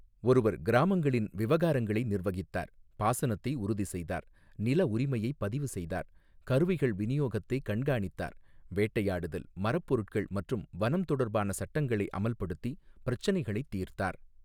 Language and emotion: Tamil, neutral